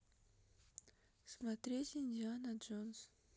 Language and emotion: Russian, neutral